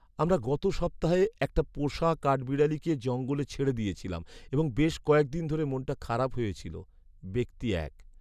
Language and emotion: Bengali, sad